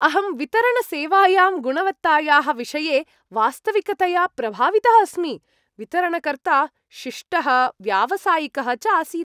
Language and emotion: Sanskrit, happy